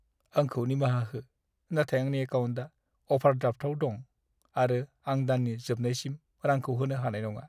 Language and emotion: Bodo, sad